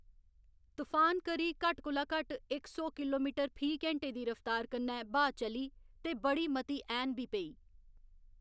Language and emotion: Dogri, neutral